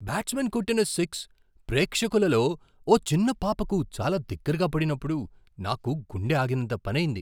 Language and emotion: Telugu, surprised